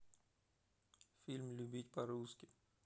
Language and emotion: Russian, neutral